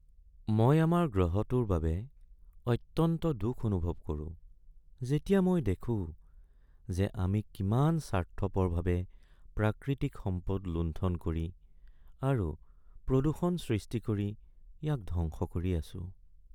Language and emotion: Assamese, sad